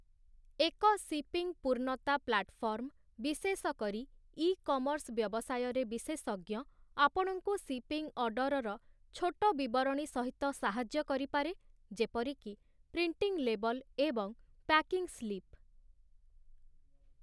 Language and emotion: Odia, neutral